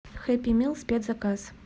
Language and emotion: Russian, neutral